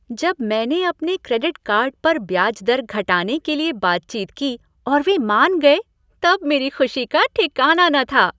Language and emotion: Hindi, happy